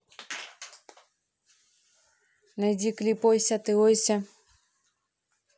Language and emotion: Russian, neutral